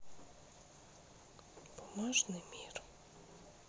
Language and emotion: Russian, sad